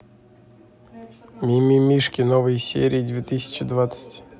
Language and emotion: Russian, neutral